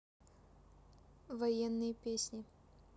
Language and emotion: Russian, neutral